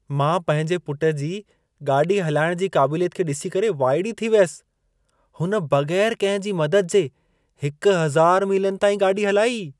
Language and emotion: Sindhi, surprised